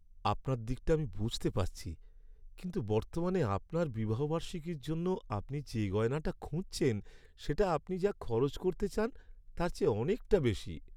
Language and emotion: Bengali, sad